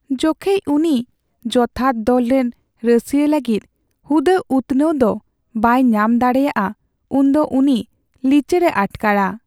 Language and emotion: Santali, sad